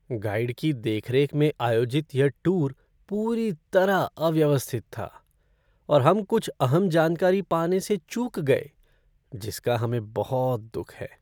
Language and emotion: Hindi, sad